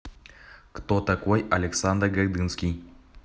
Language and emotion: Russian, neutral